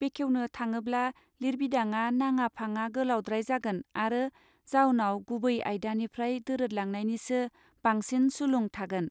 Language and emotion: Bodo, neutral